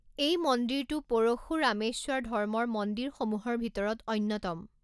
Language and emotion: Assamese, neutral